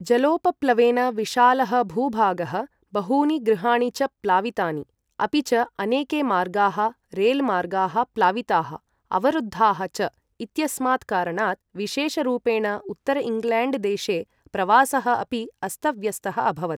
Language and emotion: Sanskrit, neutral